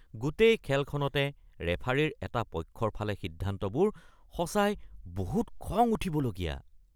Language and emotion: Assamese, disgusted